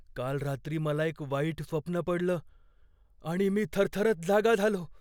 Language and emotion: Marathi, fearful